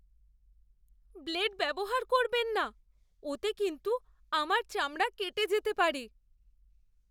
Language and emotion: Bengali, fearful